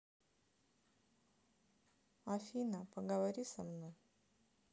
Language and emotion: Russian, sad